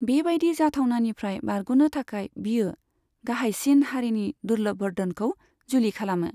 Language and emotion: Bodo, neutral